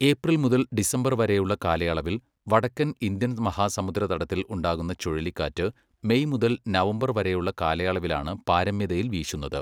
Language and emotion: Malayalam, neutral